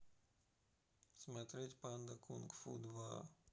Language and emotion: Russian, sad